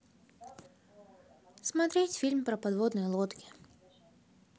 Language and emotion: Russian, neutral